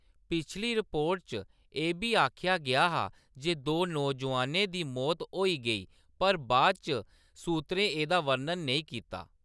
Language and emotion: Dogri, neutral